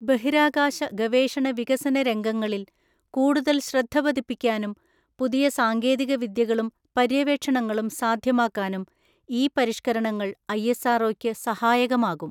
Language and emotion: Malayalam, neutral